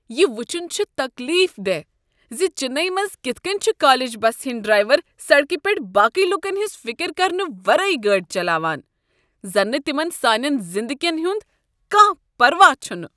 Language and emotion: Kashmiri, disgusted